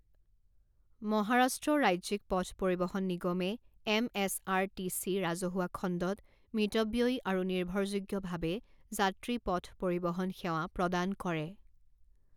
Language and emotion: Assamese, neutral